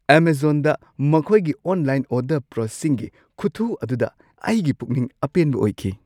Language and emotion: Manipuri, surprised